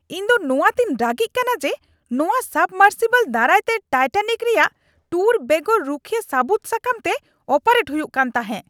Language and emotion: Santali, angry